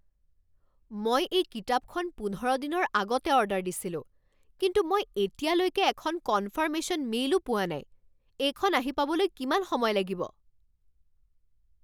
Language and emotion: Assamese, angry